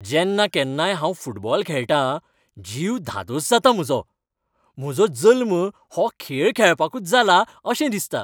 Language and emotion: Goan Konkani, happy